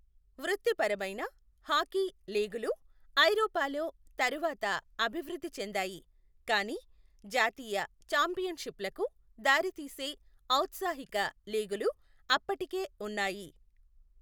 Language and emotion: Telugu, neutral